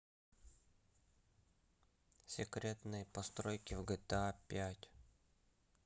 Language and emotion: Russian, neutral